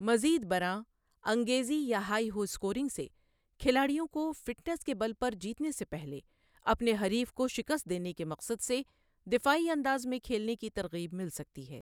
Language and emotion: Urdu, neutral